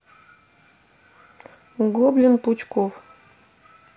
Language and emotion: Russian, neutral